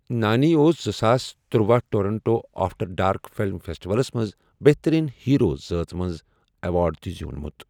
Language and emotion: Kashmiri, neutral